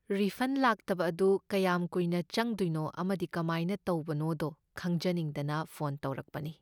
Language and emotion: Manipuri, neutral